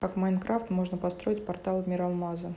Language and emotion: Russian, neutral